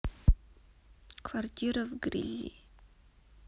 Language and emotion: Russian, sad